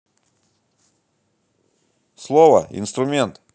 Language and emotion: Russian, neutral